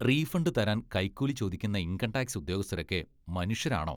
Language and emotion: Malayalam, disgusted